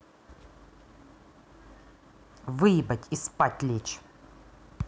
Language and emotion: Russian, angry